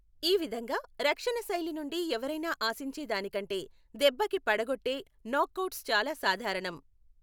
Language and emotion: Telugu, neutral